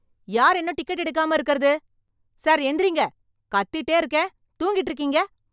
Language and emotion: Tamil, angry